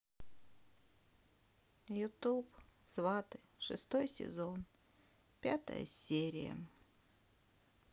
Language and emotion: Russian, sad